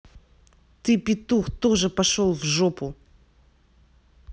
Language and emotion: Russian, angry